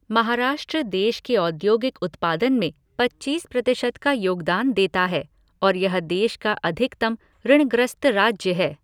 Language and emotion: Hindi, neutral